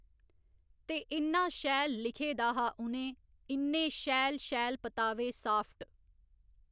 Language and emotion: Dogri, neutral